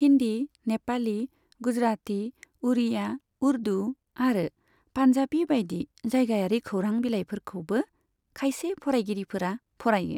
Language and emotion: Bodo, neutral